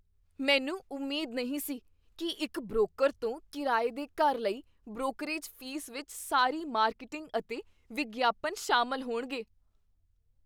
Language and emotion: Punjabi, surprised